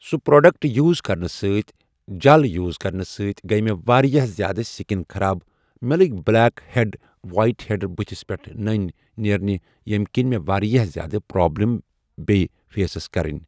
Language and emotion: Kashmiri, neutral